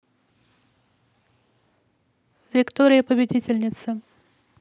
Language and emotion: Russian, neutral